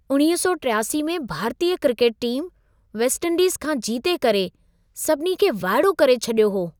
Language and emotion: Sindhi, surprised